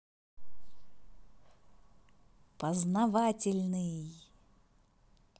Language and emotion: Russian, positive